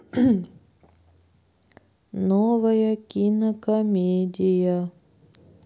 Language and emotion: Russian, sad